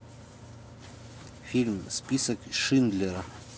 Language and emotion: Russian, neutral